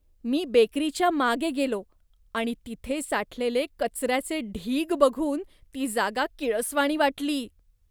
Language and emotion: Marathi, disgusted